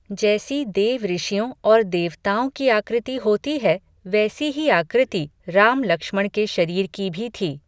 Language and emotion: Hindi, neutral